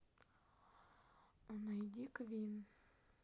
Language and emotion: Russian, sad